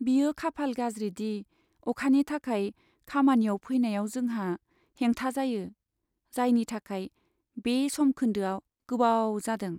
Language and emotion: Bodo, sad